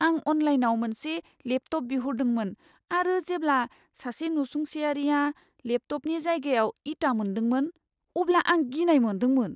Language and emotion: Bodo, fearful